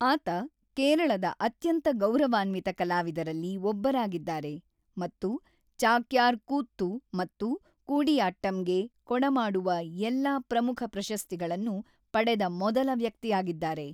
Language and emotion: Kannada, neutral